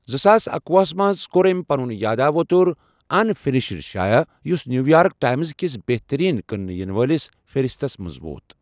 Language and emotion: Kashmiri, neutral